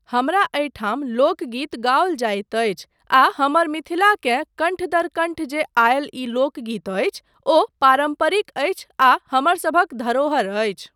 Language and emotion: Maithili, neutral